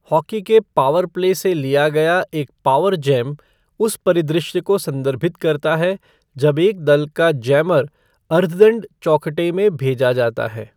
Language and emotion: Hindi, neutral